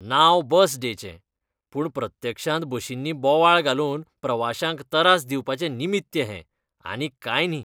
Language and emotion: Goan Konkani, disgusted